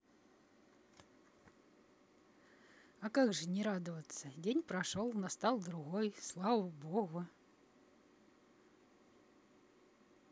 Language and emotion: Russian, positive